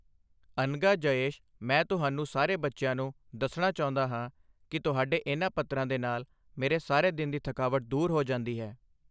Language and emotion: Punjabi, neutral